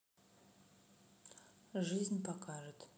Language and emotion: Russian, neutral